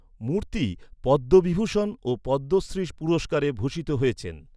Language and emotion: Bengali, neutral